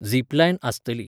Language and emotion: Goan Konkani, neutral